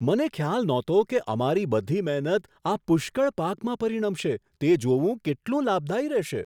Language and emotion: Gujarati, surprised